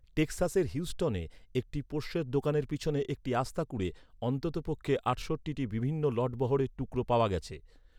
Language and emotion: Bengali, neutral